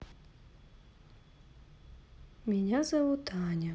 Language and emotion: Russian, neutral